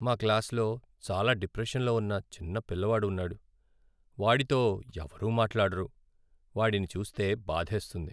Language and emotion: Telugu, sad